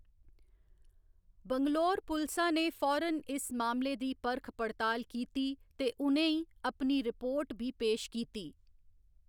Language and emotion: Dogri, neutral